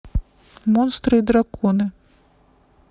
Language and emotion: Russian, neutral